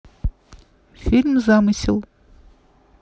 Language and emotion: Russian, neutral